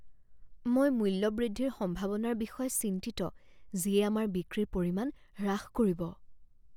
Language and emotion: Assamese, fearful